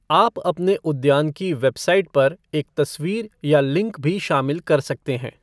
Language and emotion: Hindi, neutral